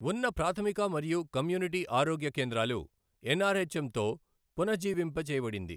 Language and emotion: Telugu, neutral